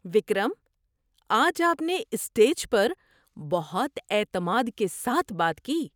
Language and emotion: Urdu, surprised